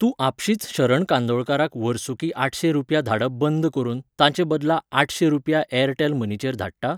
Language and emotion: Goan Konkani, neutral